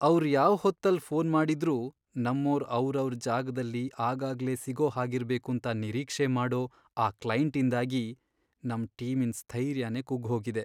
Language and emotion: Kannada, sad